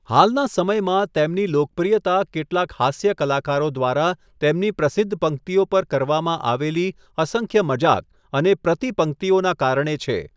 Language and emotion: Gujarati, neutral